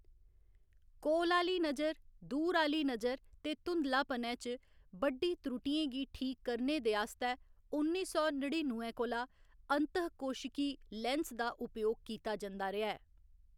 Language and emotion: Dogri, neutral